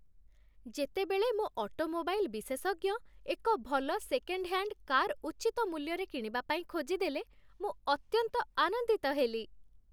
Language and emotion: Odia, happy